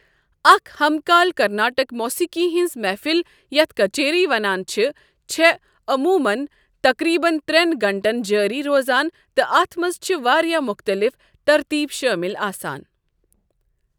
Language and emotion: Kashmiri, neutral